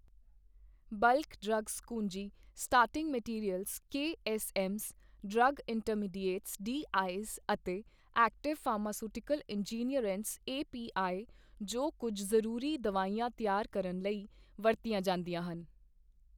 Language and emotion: Punjabi, neutral